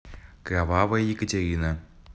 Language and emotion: Russian, neutral